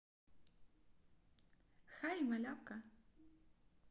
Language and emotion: Russian, positive